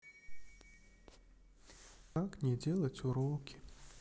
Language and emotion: Russian, sad